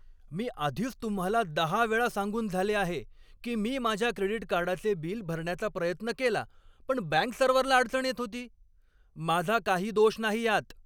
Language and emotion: Marathi, angry